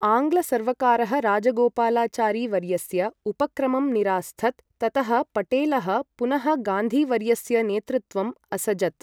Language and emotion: Sanskrit, neutral